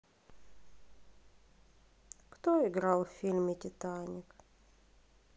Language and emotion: Russian, sad